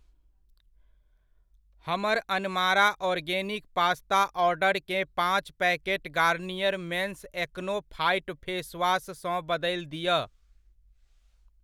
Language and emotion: Maithili, neutral